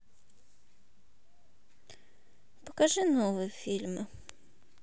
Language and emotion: Russian, sad